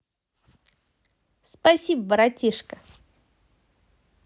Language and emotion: Russian, positive